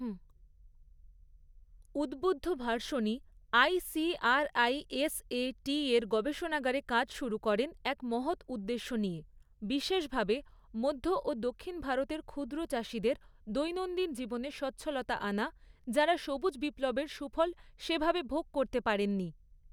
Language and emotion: Bengali, neutral